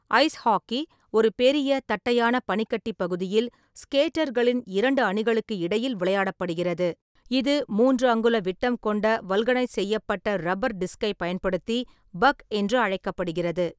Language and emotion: Tamil, neutral